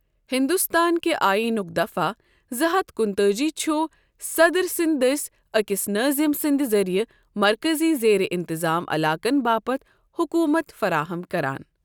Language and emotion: Kashmiri, neutral